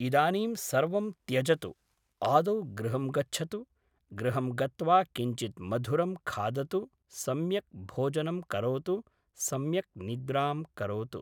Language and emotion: Sanskrit, neutral